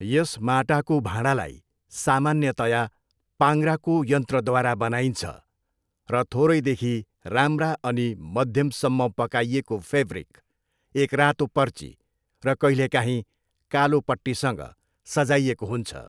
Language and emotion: Nepali, neutral